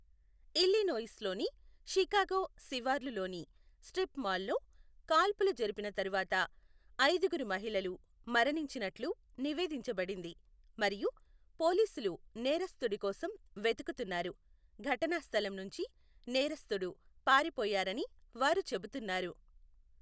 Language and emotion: Telugu, neutral